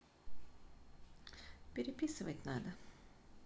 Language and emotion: Russian, neutral